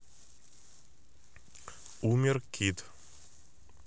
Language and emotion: Russian, neutral